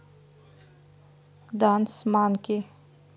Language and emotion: Russian, neutral